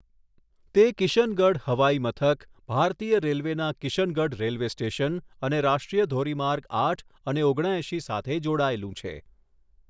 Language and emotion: Gujarati, neutral